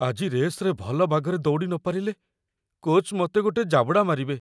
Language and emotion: Odia, fearful